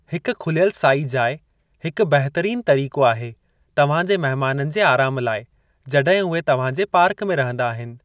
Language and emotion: Sindhi, neutral